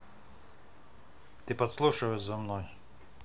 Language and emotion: Russian, neutral